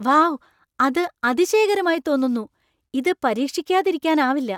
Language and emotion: Malayalam, surprised